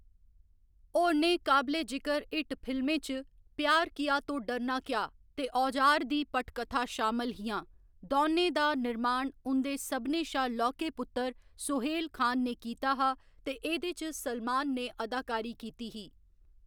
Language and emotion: Dogri, neutral